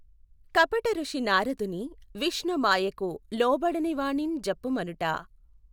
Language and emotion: Telugu, neutral